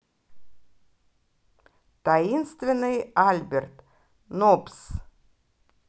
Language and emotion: Russian, positive